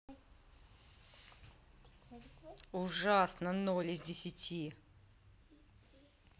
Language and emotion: Russian, angry